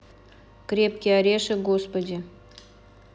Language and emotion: Russian, neutral